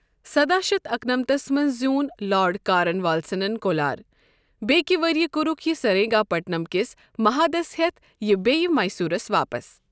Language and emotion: Kashmiri, neutral